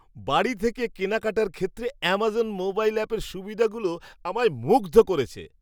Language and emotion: Bengali, surprised